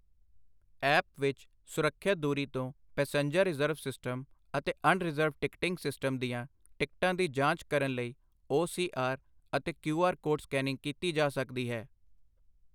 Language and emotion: Punjabi, neutral